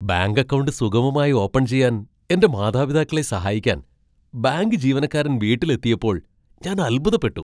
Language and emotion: Malayalam, surprised